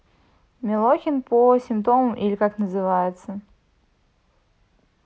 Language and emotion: Russian, neutral